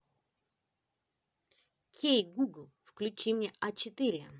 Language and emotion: Russian, positive